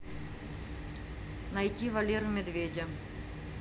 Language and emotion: Russian, neutral